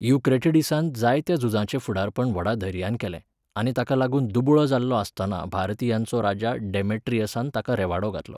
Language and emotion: Goan Konkani, neutral